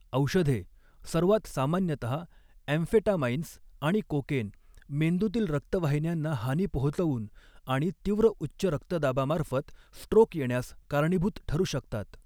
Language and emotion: Marathi, neutral